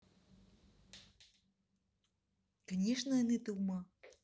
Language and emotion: Russian, neutral